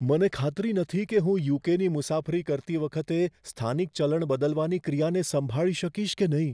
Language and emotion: Gujarati, fearful